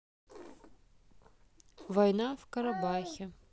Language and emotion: Russian, neutral